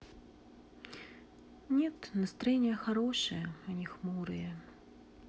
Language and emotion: Russian, sad